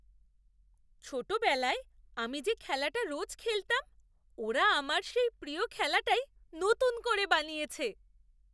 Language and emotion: Bengali, surprised